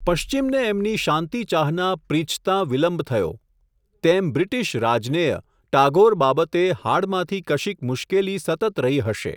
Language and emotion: Gujarati, neutral